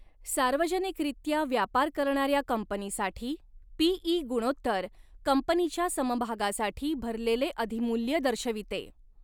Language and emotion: Marathi, neutral